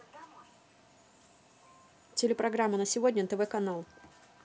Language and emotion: Russian, neutral